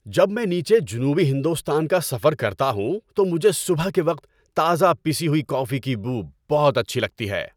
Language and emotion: Urdu, happy